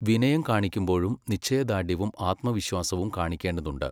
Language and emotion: Malayalam, neutral